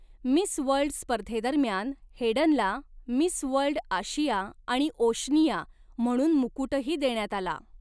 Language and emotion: Marathi, neutral